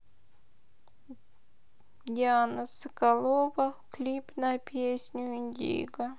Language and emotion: Russian, sad